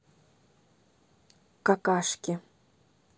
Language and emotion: Russian, neutral